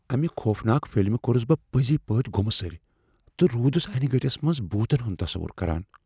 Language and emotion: Kashmiri, fearful